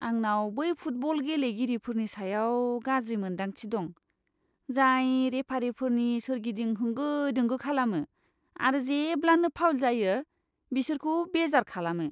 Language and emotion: Bodo, disgusted